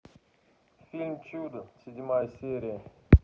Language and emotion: Russian, neutral